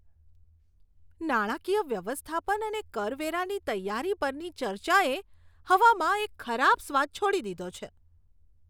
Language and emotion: Gujarati, disgusted